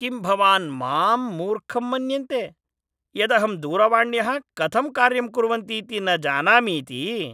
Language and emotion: Sanskrit, angry